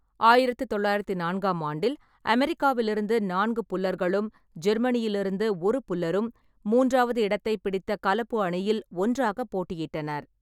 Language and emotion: Tamil, neutral